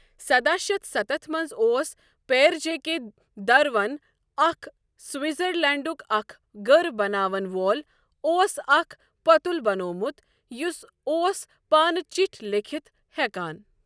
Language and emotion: Kashmiri, neutral